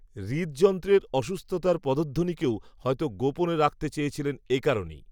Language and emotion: Bengali, neutral